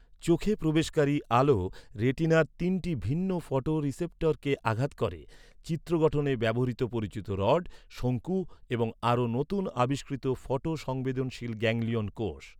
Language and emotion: Bengali, neutral